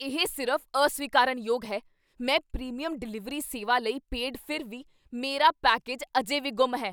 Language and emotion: Punjabi, angry